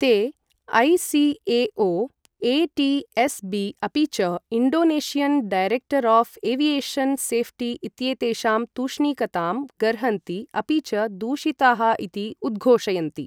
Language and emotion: Sanskrit, neutral